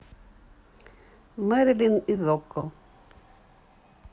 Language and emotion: Russian, neutral